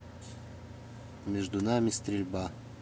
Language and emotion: Russian, neutral